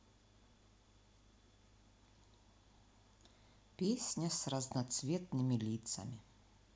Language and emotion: Russian, neutral